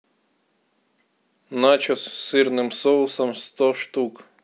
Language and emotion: Russian, neutral